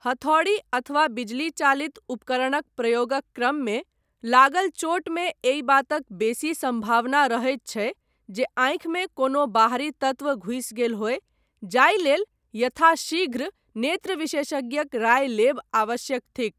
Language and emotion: Maithili, neutral